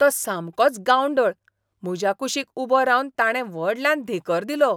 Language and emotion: Goan Konkani, disgusted